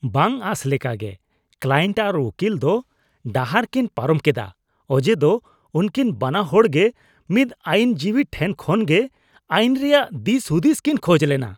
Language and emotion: Santali, disgusted